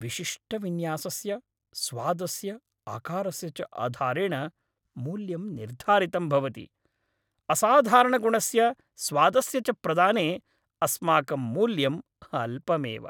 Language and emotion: Sanskrit, happy